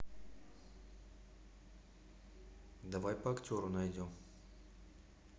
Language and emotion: Russian, neutral